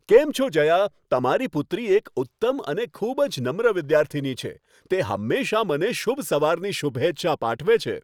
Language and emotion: Gujarati, happy